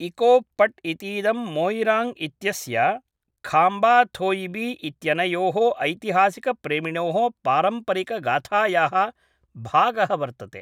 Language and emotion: Sanskrit, neutral